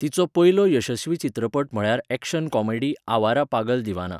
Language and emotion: Goan Konkani, neutral